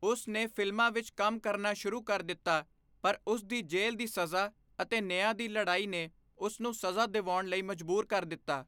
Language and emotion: Punjabi, neutral